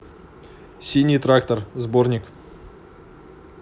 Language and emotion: Russian, neutral